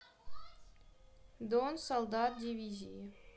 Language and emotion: Russian, neutral